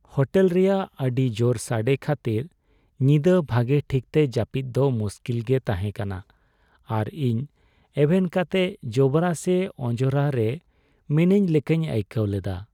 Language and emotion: Santali, sad